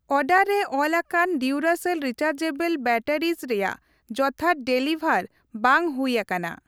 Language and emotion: Santali, neutral